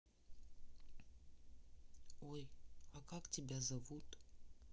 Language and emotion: Russian, neutral